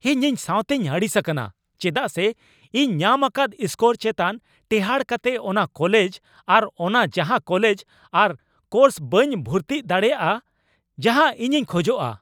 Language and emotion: Santali, angry